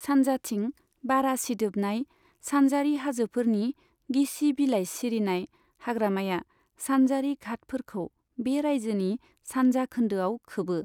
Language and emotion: Bodo, neutral